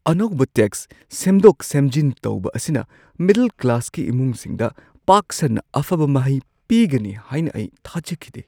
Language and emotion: Manipuri, surprised